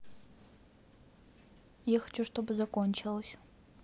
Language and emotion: Russian, neutral